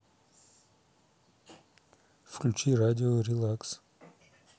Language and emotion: Russian, neutral